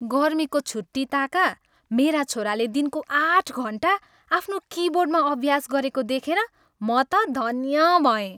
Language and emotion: Nepali, happy